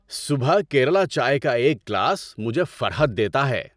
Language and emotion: Urdu, happy